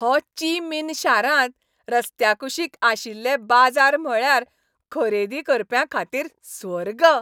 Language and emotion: Goan Konkani, happy